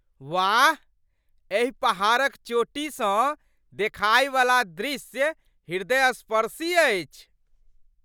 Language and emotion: Maithili, surprised